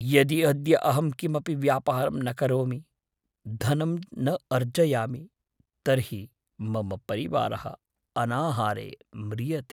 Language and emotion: Sanskrit, fearful